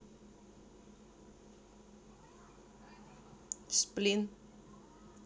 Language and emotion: Russian, neutral